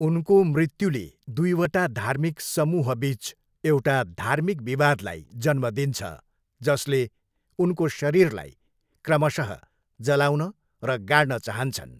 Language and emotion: Nepali, neutral